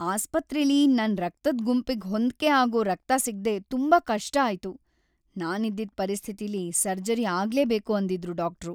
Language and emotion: Kannada, sad